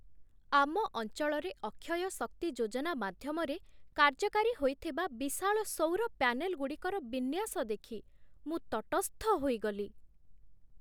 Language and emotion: Odia, surprised